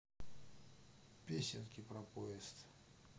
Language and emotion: Russian, neutral